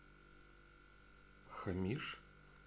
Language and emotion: Russian, neutral